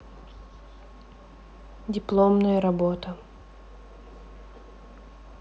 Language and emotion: Russian, neutral